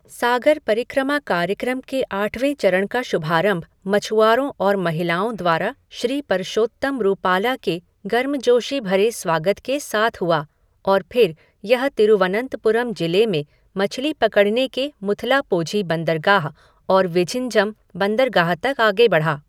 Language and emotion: Hindi, neutral